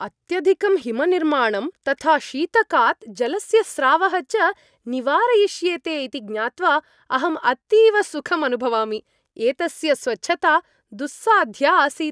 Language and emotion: Sanskrit, happy